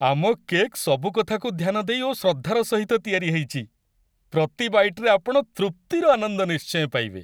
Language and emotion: Odia, happy